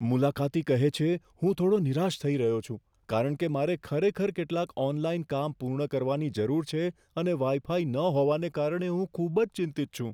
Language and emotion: Gujarati, fearful